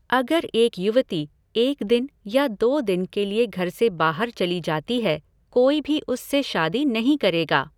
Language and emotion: Hindi, neutral